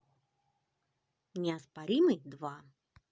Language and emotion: Russian, positive